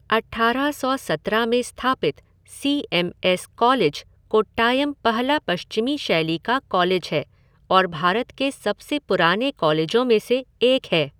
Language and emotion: Hindi, neutral